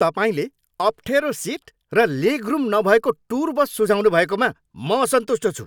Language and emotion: Nepali, angry